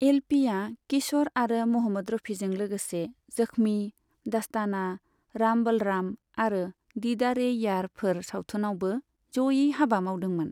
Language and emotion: Bodo, neutral